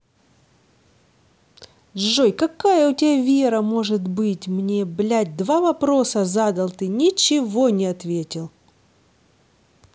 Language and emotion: Russian, angry